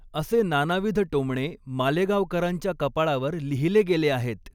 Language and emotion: Marathi, neutral